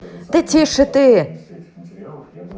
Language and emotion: Russian, angry